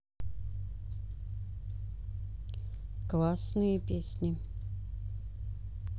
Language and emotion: Russian, neutral